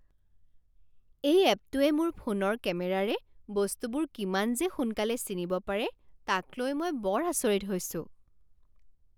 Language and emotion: Assamese, surprised